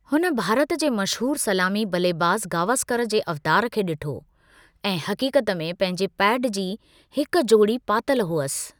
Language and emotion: Sindhi, neutral